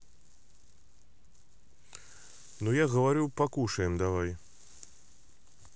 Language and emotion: Russian, neutral